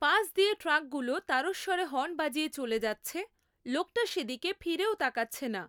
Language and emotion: Bengali, neutral